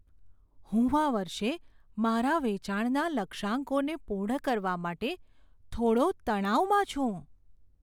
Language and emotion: Gujarati, fearful